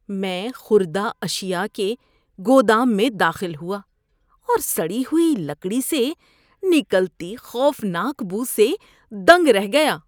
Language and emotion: Urdu, disgusted